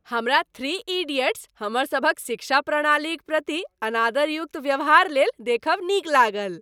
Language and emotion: Maithili, happy